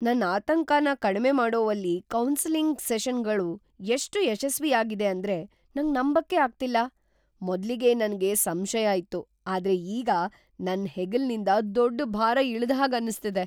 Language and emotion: Kannada, surprised